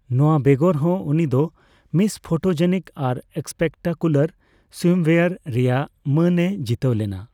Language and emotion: Santali, neutral